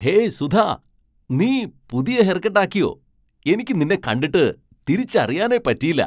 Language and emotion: Malayalam, surprised